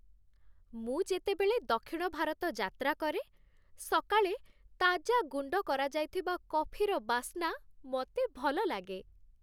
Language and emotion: Odia, happy